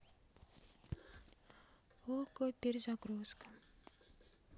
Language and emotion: Russian, neutral